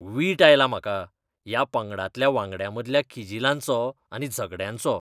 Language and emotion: Goan Konkani, disgusted